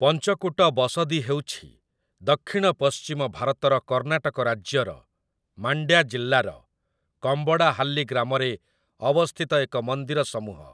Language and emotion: Odia, neutral